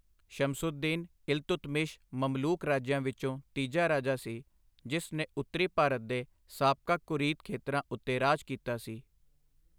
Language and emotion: Punjabi, neutral